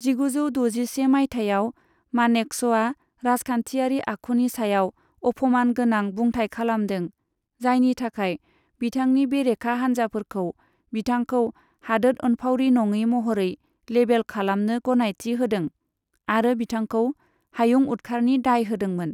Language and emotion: Bodo, neutral